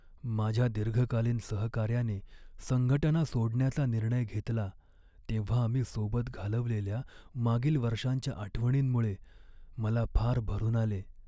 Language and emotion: Marathi, sad